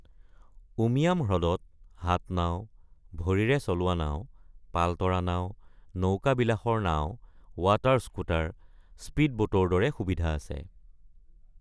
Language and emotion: Assamese, neutral